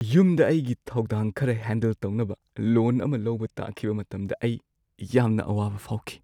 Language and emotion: Manipuri, sad